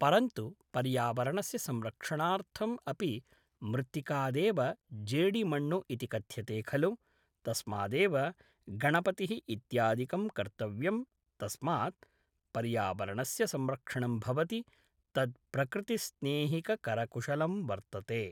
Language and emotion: Sanskrit, neutral